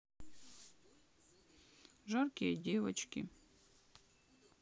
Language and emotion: Russian, sad